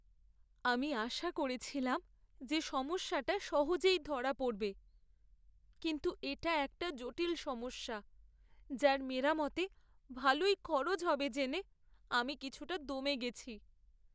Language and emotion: Bengali, sad